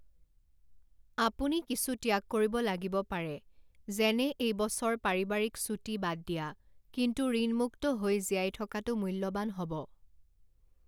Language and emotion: Assamese, neutral